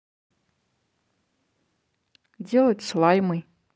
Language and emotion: Russian, neutral